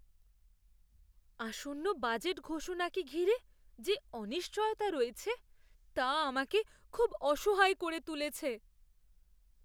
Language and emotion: Bengali, fearful